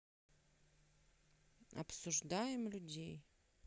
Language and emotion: Russian, neutral